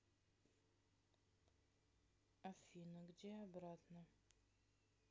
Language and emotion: Russian, neutral